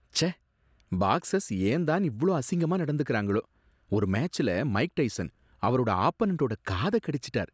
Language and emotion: Tamil, disgusted